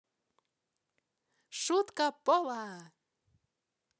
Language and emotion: Russian, positive